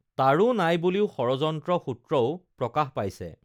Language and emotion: Assamese, neutral